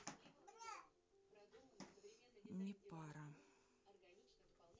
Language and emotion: Russian, sad